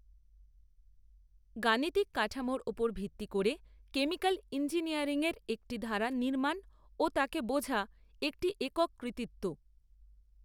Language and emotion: Bengali, neutral